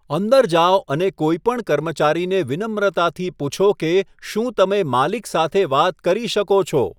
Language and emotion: Gujarati, neutral